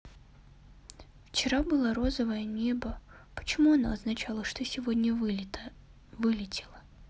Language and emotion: Russian, sad